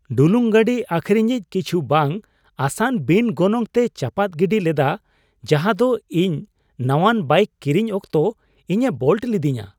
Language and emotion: Santali, surprised